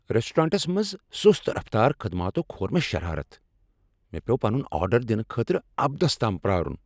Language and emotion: Kashmiri, angry